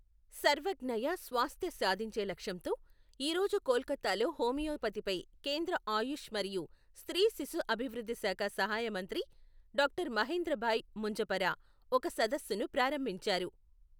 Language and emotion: Telugu, neutral